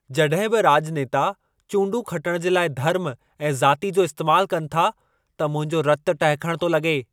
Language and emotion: Sindhi, angry